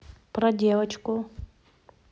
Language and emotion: Russian, neutral